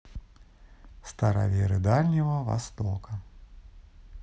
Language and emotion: Russian, neutral